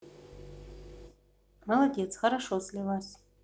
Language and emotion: Russian, neutral